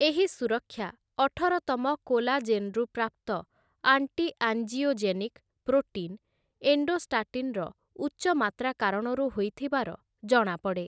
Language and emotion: Odia, neutral